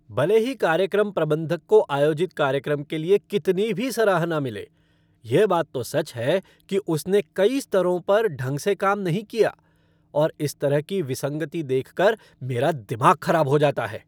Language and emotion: Hindi, angry